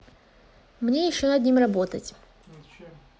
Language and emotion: Russian, neutral